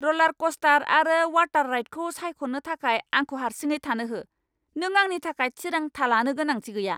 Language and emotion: Bodo, angry